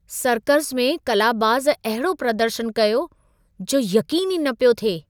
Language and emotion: Sindhi, surprised